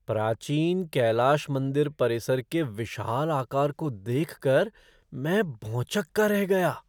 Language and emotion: Hindi, surprised